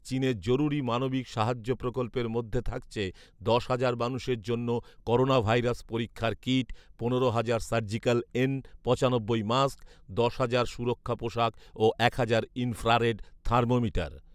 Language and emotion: Bengali, neutral